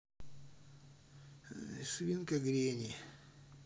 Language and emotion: Russian, sad